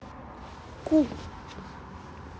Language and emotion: Russian, neutral